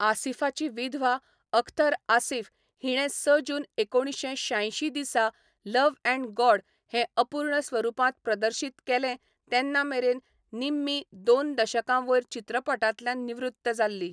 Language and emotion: Goan Konkani, neutral